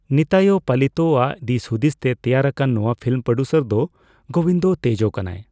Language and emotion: Santali, neutral